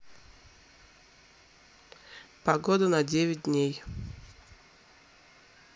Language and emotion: Russian, neutral